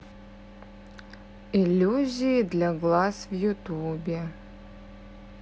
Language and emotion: Russian, neutral